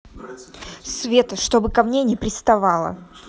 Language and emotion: Russian, angry